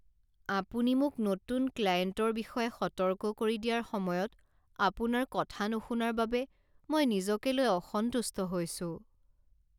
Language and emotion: Assamese, sad